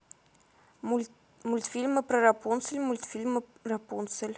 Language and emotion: Russian, neutral